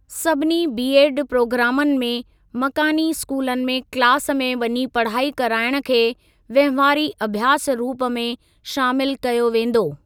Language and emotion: Sindhi, neutral